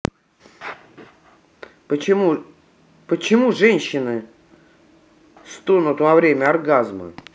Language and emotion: Russian, angry